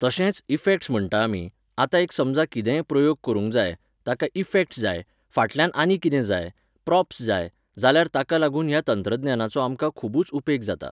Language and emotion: Goan Konkani, neutral